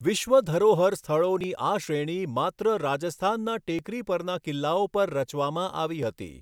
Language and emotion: Gujarati, neutral